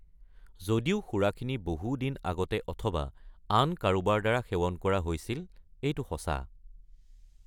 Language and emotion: Assamese, neutral